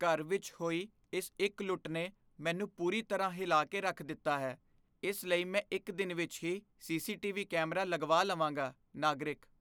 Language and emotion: Punjabi, fearful